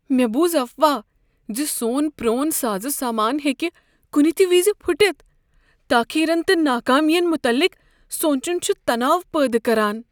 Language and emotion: Kashmiri, fearful